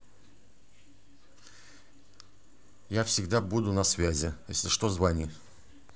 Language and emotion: Russian, neutral